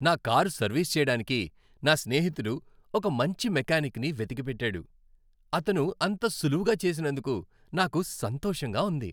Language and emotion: Telugu, happy